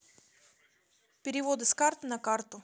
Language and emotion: Russian, neutral